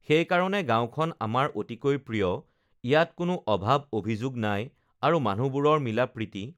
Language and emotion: Assamese, neutral